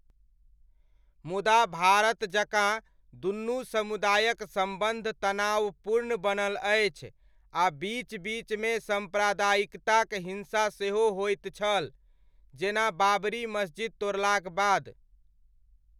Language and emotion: Maithili, neutral